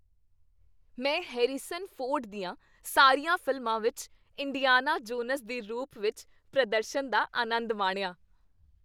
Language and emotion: Punjabi, happy